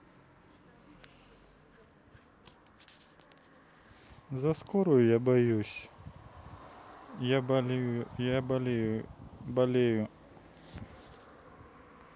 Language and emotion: Russian, sad